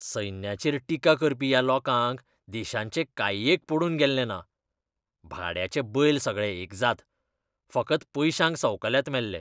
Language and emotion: Goan Konkani, disgusted